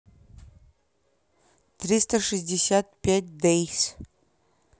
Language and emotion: Russian, neutral